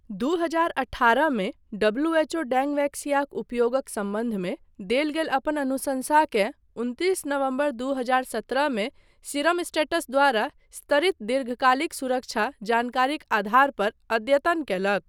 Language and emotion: Maithili, neutral